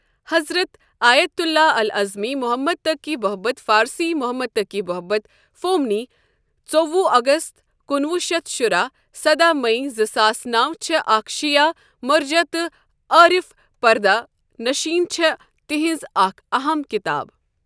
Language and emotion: Kashmiri, neutral